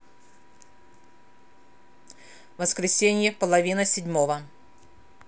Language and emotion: Russian, neutral